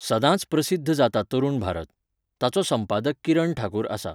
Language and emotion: Goan Konkani, neutral